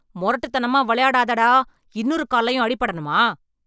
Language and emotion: Tamil, angry